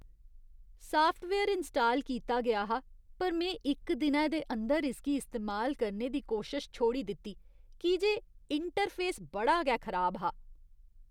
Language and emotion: Dogri, disgusted